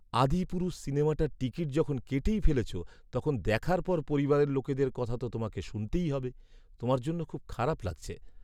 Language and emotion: Bengali, sad